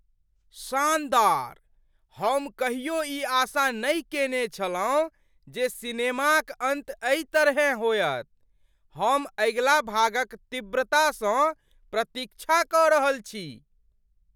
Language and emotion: Maithili, surprised